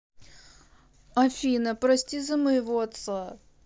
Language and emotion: Russian, sad